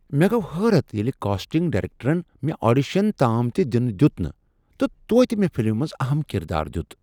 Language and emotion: Kashmiri, surprised